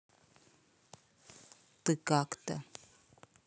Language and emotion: Russian, neutral